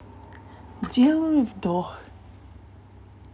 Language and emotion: Russian, neutral